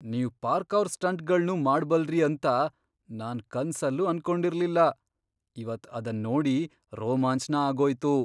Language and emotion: Kannada, surprised